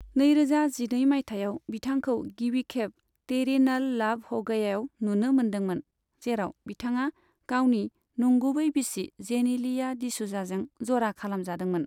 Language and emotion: Bodo, neutral